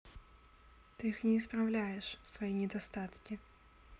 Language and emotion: Russian, neutral